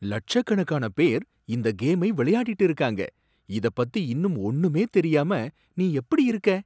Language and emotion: Tamil, surprised